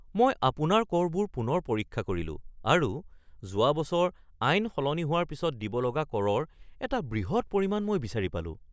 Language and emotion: Assamese, surprised